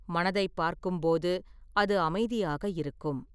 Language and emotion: Tamil, neutral